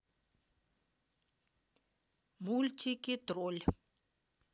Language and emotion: Russian, neutral